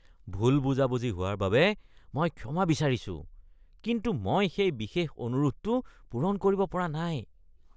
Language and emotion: Assamese, disgusted